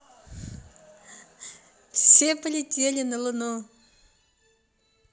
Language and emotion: Russian, positive